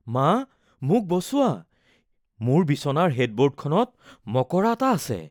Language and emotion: Assamese, fearful